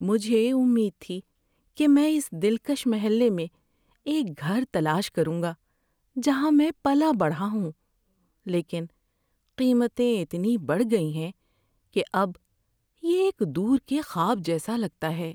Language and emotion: Urdu, sad